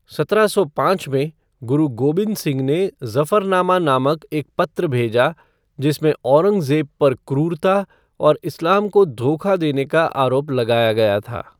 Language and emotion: Hindi, neutral